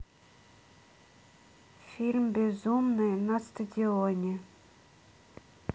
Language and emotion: Russian, neutral